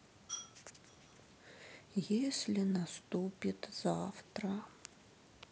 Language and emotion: Russian, sad